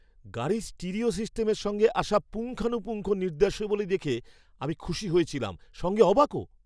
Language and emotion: Bengali, surprised